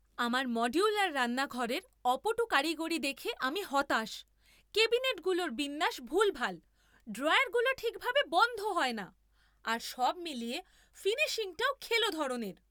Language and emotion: Bengali, angry